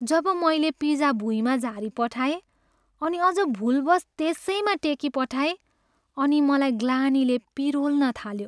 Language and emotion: Nepali, sad